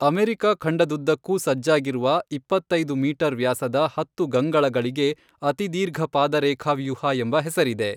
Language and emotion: Kannada, neutral